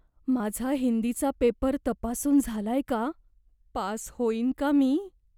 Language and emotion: Marathi, fearful